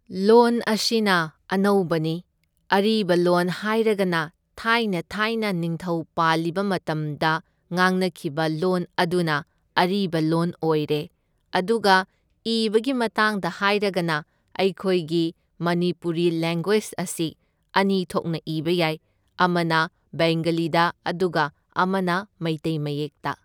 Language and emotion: Manipuri, neutral